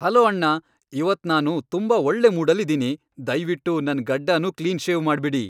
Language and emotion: Kannada, happy